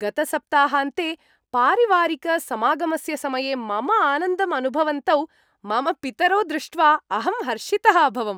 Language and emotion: Sanskrit, happy